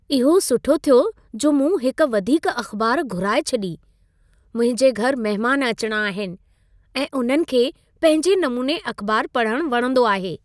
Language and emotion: Sindhi, happy